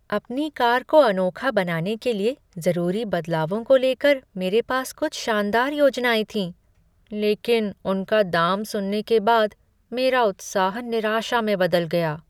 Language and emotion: Hindi, sad